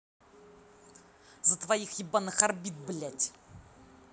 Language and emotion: Russian, angry